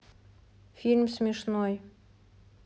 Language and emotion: Russian, neutral